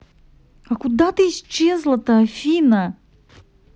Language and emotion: Russian, angry